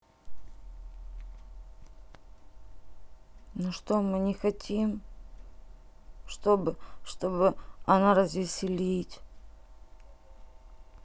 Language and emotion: Russian, sad